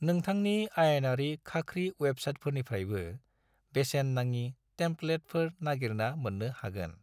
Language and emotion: Bodo, neutral